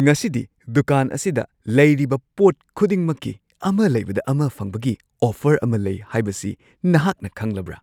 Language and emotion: Manipuri, surprised